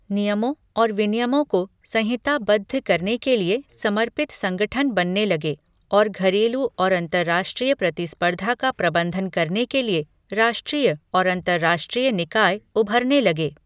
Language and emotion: Hindi, neutral